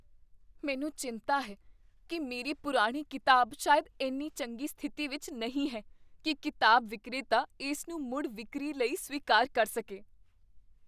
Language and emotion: Punjabi, fearful